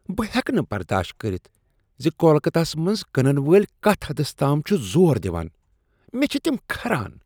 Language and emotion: Kashmiri, disgusted